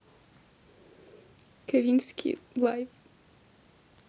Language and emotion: Russian, sad